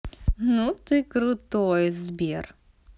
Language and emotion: Russian, positive